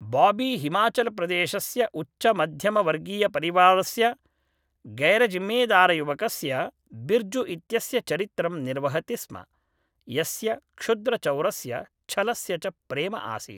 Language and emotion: Sanskrit, neutral